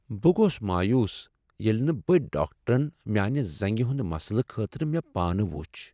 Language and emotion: Kashmiri, sad